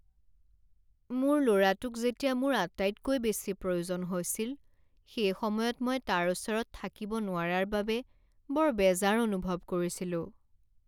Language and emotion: Assamese, sad